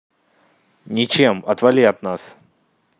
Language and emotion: Russian, angry